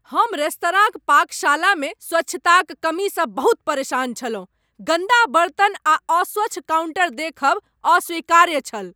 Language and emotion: Maithili, angry